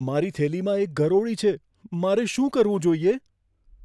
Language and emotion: Gujarati, fearful